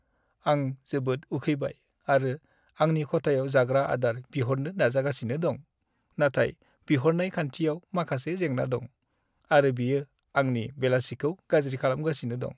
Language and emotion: Bodo, sad